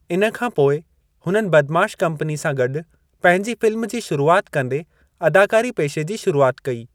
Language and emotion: Sindhi, neutral